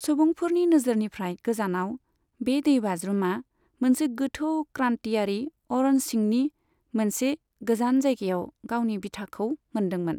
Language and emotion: Bodo, neutral